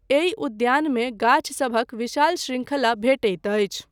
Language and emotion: Maithili, neutral